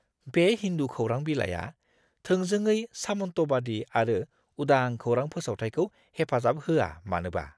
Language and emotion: Bodo, disgusted